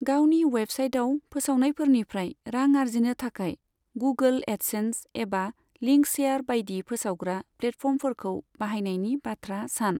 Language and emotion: Bodo, neutral